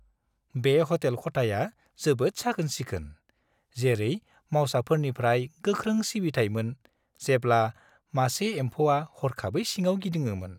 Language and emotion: Bodo, happy